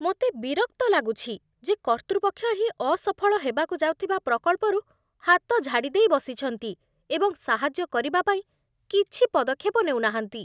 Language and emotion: Odia, disgusted